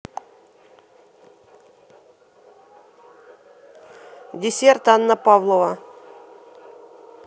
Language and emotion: Russian, neutral